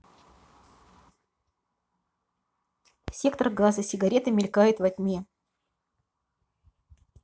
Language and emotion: Russian, neutral